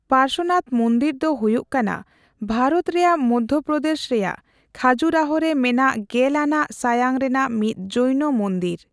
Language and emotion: Santali, neutral